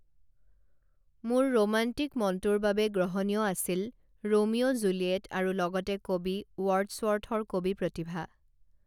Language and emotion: Assamese, neutral